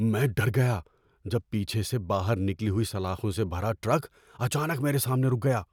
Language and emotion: Urdu, fearful